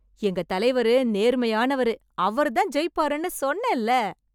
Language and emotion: Tamil, happy